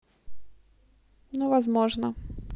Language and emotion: Russian, neutral